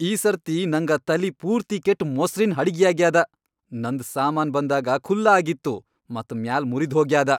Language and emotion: Kannada, angry